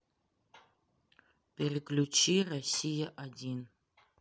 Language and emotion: Russian, neutral